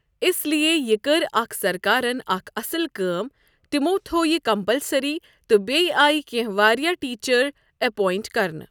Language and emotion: Kashmiri, neutral